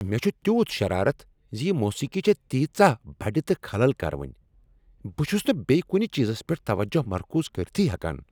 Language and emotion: Kashmiri, angry